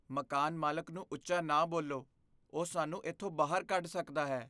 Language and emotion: Punjabi, fearful